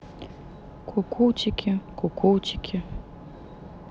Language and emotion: Russian, sad